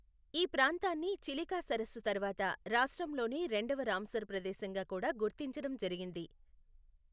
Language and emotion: Telugu, neutral